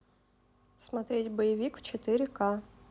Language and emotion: Russian, neutral